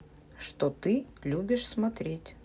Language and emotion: Russian, neutral